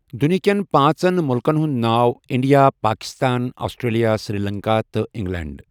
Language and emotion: Kashmiri, neutral